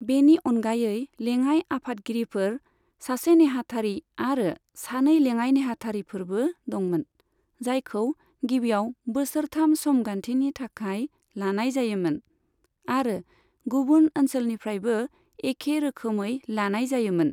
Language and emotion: Bodo, neutral